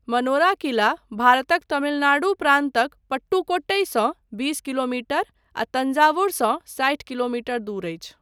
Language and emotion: Maithili, neutral